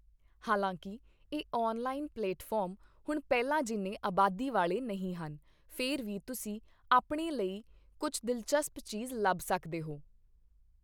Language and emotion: Punjabi, neutral